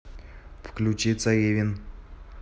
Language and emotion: Russian, neutral